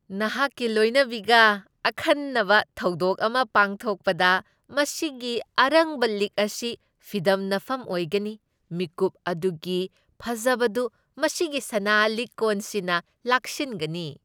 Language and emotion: Manipuri, happy